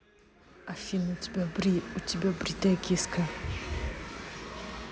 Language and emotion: Russian, neutral